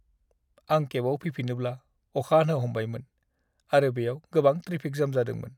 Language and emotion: Bodo, sad